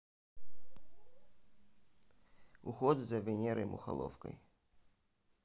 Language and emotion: Russian, neutral